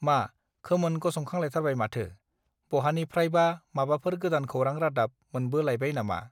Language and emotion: Bodo, neutral